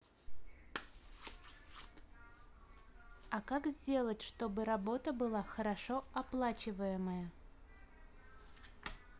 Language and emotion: Russian, neutral